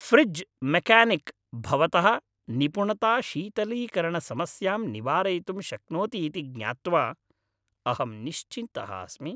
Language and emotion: Sanskrit, happy